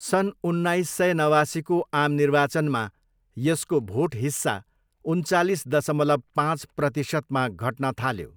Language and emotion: Nepali, neutral